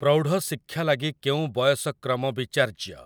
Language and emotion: Odia, neutral